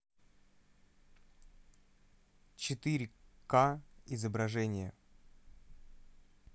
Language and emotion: Russian, neutral